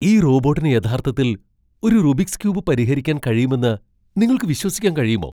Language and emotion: Malayalam, surprised